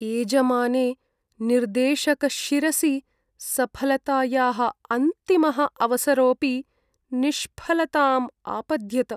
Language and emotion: Sanskrit, sad